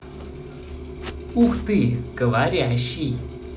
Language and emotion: Russian, positive